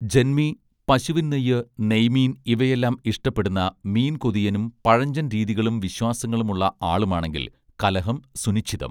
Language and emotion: Malayalam, neutral